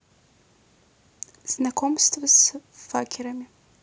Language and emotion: Russian, neutral